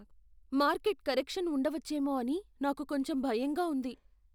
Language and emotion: Telugu, fearful